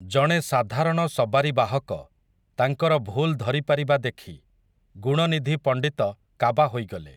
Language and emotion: Odia, neutral